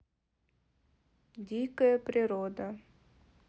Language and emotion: Russian, neutral